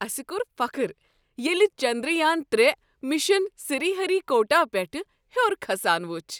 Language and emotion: Kashmiri, happy